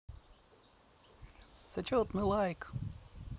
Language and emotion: Russian, positive